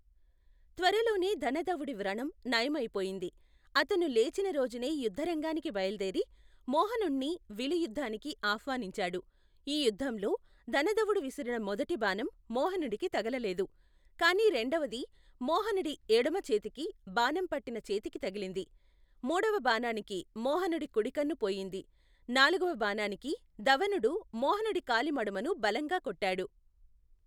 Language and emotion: Telugu, neutral